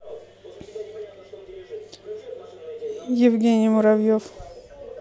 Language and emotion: Russian, neutral